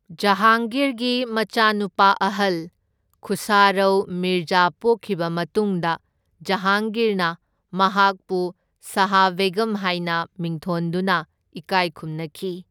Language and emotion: Manipuri, neutral